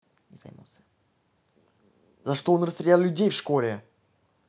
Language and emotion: Russian, angry